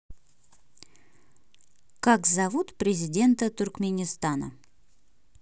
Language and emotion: Russian, neutral